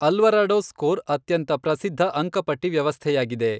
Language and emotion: Kannada, neutral